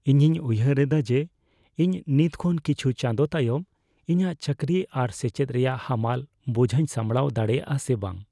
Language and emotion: Santali, fearful